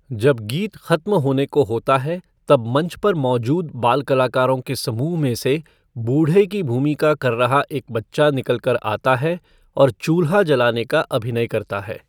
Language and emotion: Hindi, neutral